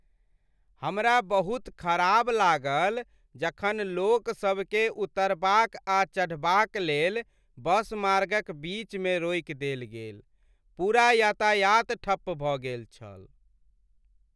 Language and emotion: Maithili, sad